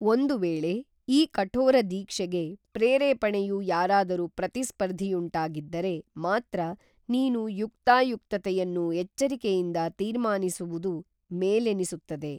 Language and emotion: Kannada, neutral